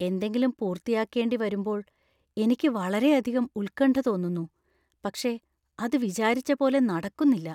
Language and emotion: Malayalam, fearful